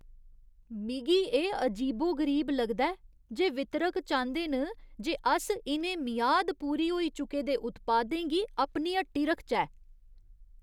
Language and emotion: Dogri, disgusted